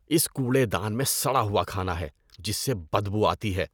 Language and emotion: Urdu, disgusted